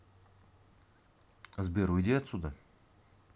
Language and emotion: Russian, angry